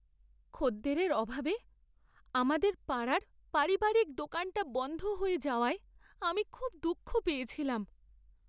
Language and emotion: Bengali, sad